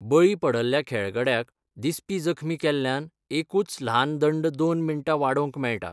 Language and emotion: Goan Konkani, neutral